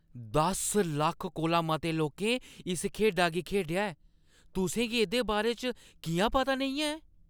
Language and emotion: Dogri, surprised